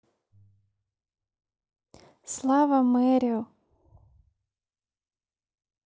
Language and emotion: Russian, neutral